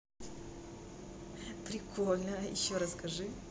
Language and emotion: Russian, positive